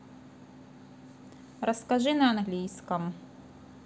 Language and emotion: Russian, neutral